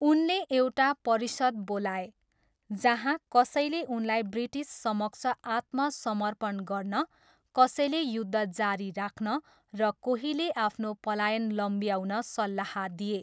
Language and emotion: Nepali, neutral